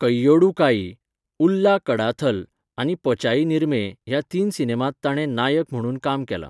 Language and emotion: Goan Konkani, neutral